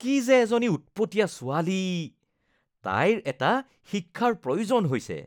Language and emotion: Assamese, disgusted